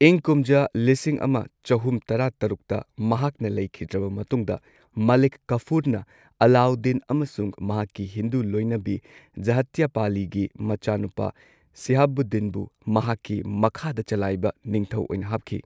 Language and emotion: Manipuri, neutral